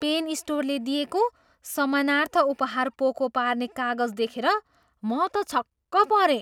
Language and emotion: Nepali, surprised